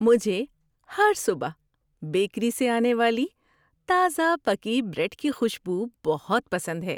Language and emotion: Urdu, happy